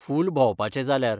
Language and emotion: Goan Konkani, neutral